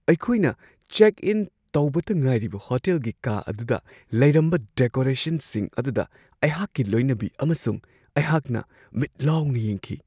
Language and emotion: Manipuri, surprised